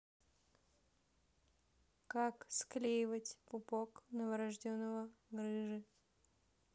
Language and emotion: Russian, neutral